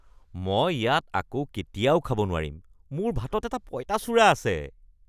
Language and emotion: Assamese, disgusted